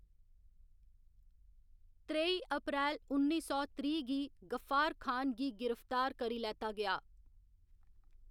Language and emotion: Dogri, neutral